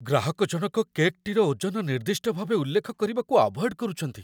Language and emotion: Odia, fearful